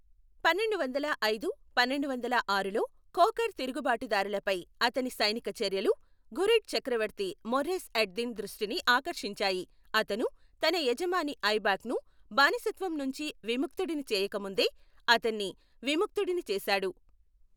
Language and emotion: Telugu, neutral